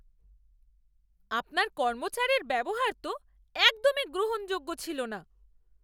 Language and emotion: Bengali, angry